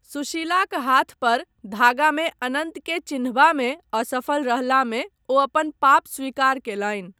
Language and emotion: Maithili, neutral